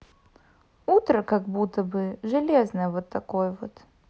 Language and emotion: Russian, neutral